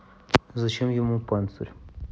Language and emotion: Russian, neutral